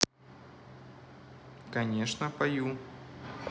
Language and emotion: Russian, neutral